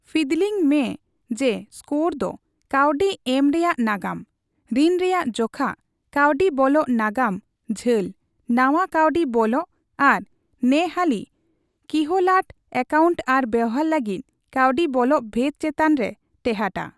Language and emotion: Santali, neutral